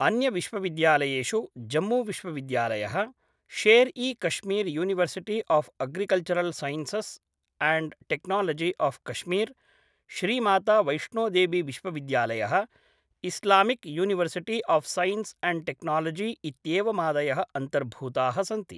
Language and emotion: Sanskrit, neutral